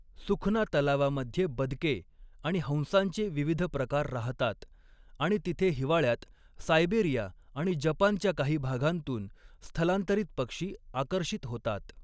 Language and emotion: Marathi, neutral